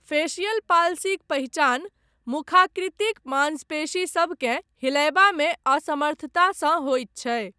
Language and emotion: Maithili, neutral